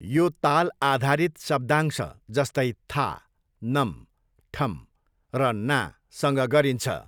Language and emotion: Nepali, neutral